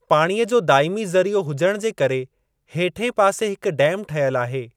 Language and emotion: Sindhi, neutral